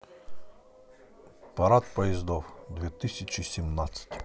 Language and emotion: Russian, neutral